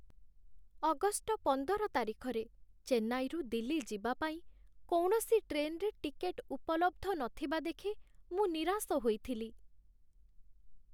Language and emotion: Odia, sad